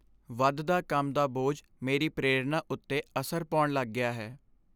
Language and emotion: Punjabi, sad